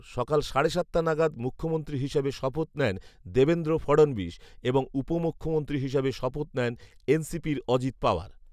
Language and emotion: Bengali, neutral